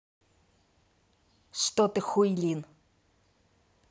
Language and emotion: Russian, angry